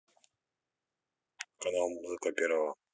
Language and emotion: Russian, neutral